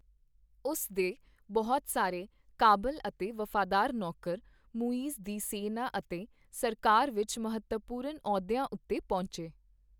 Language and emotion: Punjabi, neutral